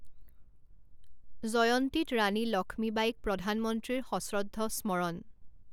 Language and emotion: Assamese, neutral